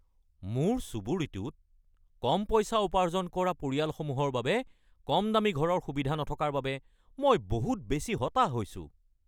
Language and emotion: Assamese, angry